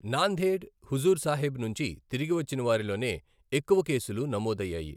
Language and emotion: Telugu, neutral